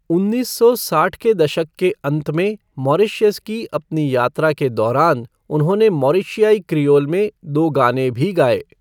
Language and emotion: Hindi, neutral